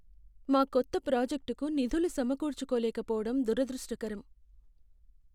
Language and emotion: Telugu, sad